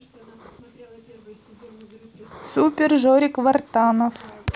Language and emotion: Russian, neutral